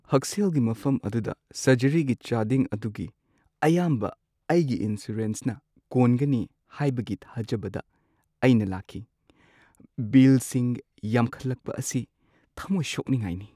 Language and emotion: Manipuri, sad